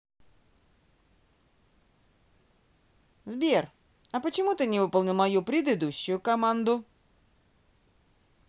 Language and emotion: Russian, neutral